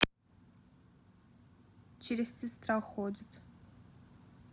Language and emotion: Russian, neutral